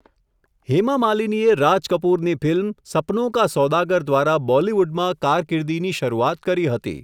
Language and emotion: Gujarati, neutral